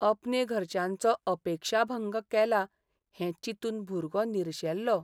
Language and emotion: Goan Konkani, sad